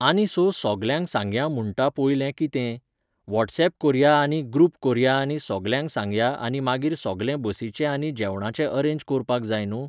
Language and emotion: Goan Konkani, neutral